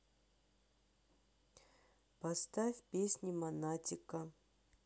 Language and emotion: Russian, neutral